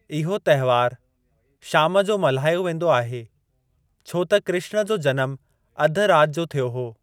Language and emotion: Sindhi, neutral